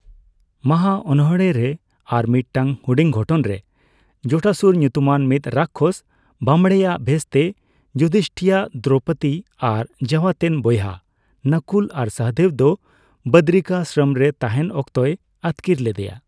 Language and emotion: Santali, neutral